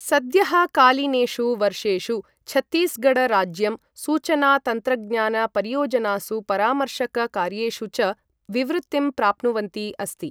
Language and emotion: Sanskrit, neutral